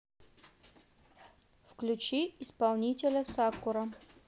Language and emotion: Russian, neutral